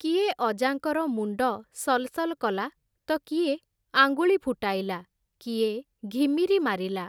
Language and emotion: Odia, neutral